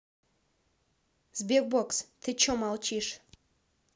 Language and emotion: Russian, neutral